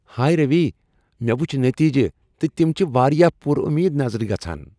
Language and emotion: Kashmiri, happy